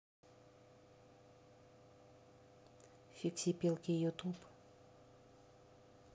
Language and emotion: Russian, neutral